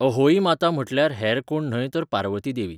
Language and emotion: Goan Konkani, neutral